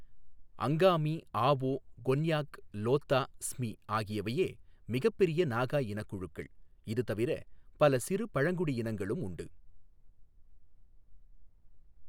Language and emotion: Tamil, neutral